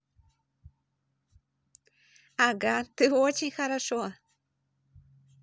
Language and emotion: Russian, positive